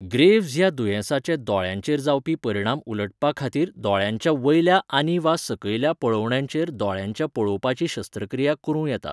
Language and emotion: Goan Konkani, neutral